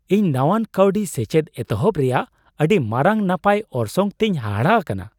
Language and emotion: Santali, surprised